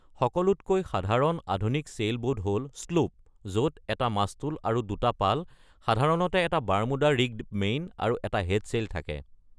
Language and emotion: Assamese, neutral